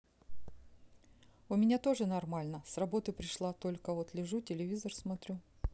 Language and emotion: Russian, neutral